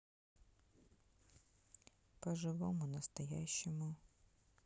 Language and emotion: Russian, neutral